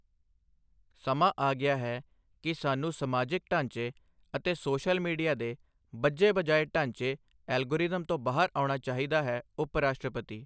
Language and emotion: Punjabi, neutral